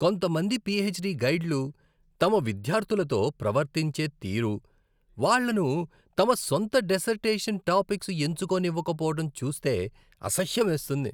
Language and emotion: Telugu, disgusted